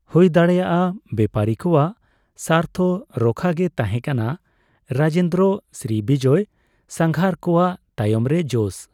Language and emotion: Santali, neutral